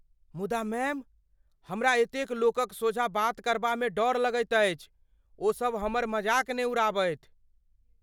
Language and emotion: Maithili, fearful